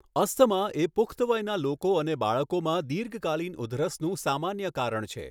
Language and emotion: Gujarati, neutral